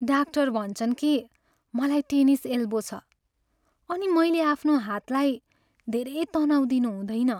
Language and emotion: Nepali, sad